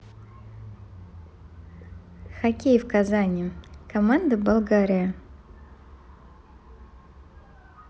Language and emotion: Russian, neutral